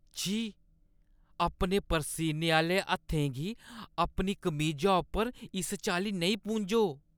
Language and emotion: Dogri, disgusted